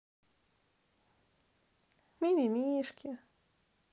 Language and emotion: Russian, positive